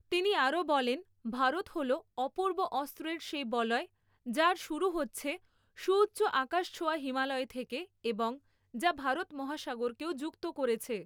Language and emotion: Bengali, neutral